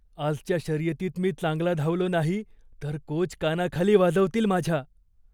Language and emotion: Marathi, fearful